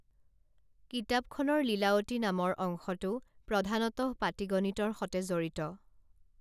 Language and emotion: Assamese, neutral